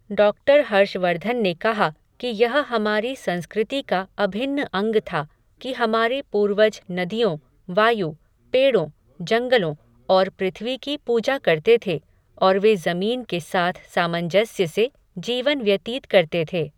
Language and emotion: Hindi, neutral